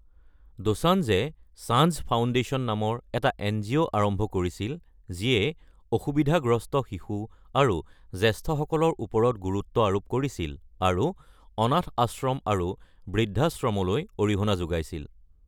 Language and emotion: Assamese, neutral